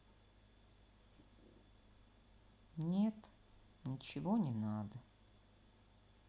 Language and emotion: Russian, sad